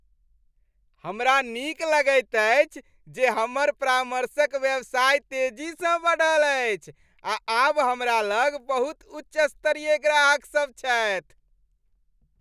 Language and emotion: Maithili, happy